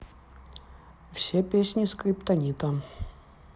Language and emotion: Russian, neutral